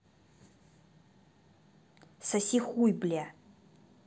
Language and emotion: Russian, angry